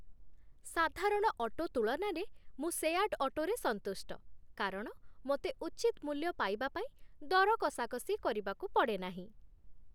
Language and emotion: Odia, happy